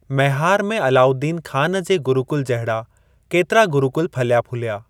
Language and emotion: Sindhi, neutral